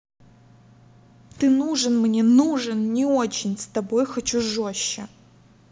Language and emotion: Russian, angry